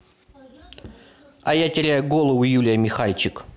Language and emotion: Russian, neutral